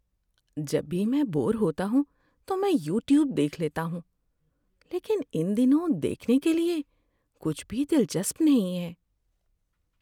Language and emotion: Urdu, sad